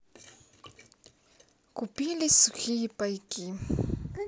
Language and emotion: Russian, neutral